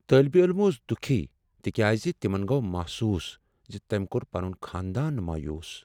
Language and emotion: Kashmiri, sad